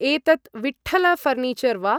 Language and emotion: Sanskrit, neutral